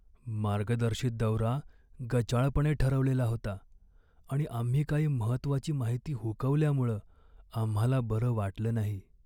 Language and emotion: Marathi, sad